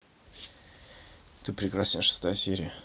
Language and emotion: Russian, neutral